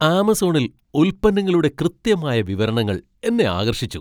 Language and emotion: Malayalam, surprised